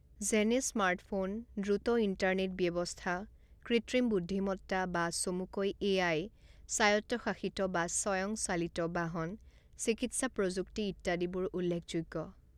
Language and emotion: Assamese, neutral